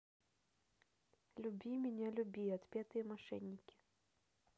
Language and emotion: Russian, neutral